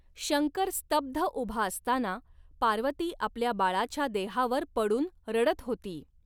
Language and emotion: Marathi, neutral